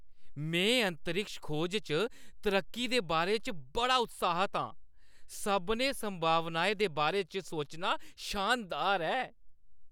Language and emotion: Dogri, happy